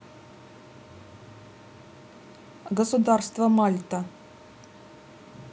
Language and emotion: Russian, neutral